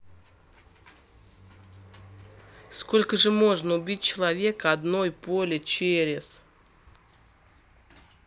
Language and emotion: Russian, neutral